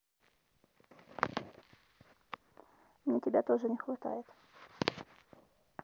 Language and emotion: Russian, neutral